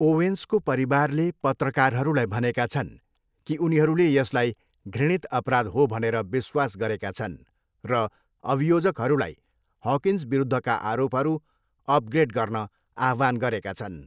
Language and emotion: Nepali, neutral